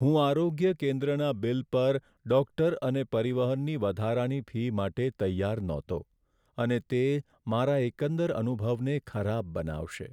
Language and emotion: Gujarati, sad